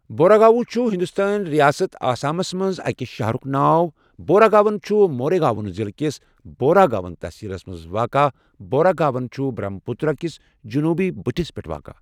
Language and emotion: Kashmiri, neutral